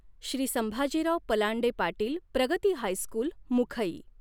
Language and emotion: Marathi, neutral